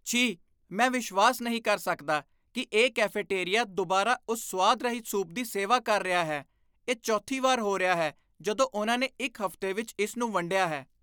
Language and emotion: Punjabi, disgusted